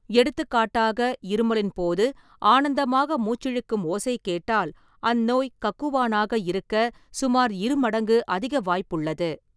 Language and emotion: Tamil, neutral